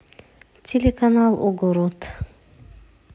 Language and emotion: Russian, neutral